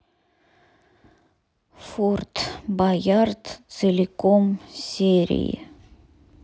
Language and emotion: Russian, sad